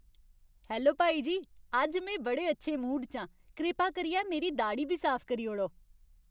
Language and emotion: Dogri, happy